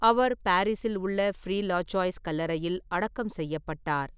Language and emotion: Tamil, neutral